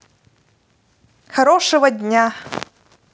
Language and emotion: Russian, positive